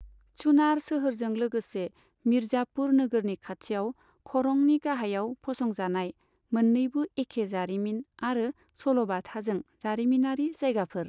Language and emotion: Bodo, neutral